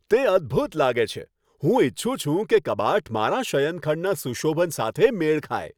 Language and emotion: Gujarati, happy